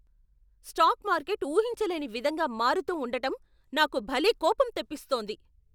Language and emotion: Telugu, angry